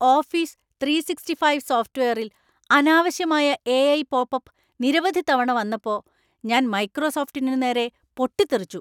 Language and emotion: Malayalam, angry